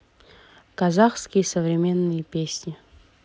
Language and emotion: Russian, neutral